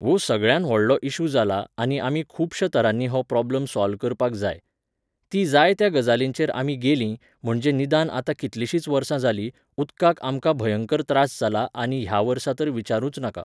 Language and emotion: Goan Konkani, neutral